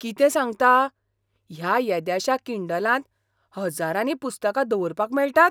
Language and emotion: Goan Konkani, surprised